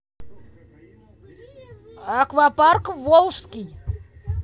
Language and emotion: Russian, neutral